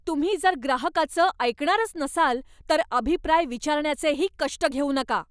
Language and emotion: Marathi, angry